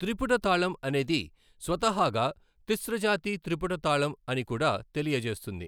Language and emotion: Telugu, neutral